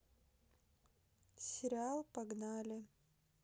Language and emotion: Russian, neutral